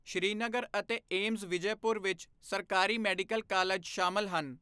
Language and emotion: Punjabi, neutral